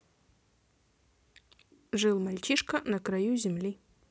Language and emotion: Russian, positive